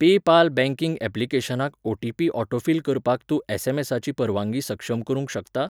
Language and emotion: Goan Konkani, neutral